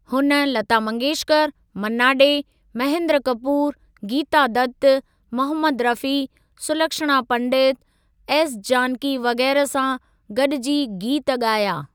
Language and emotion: Sindhi, neutral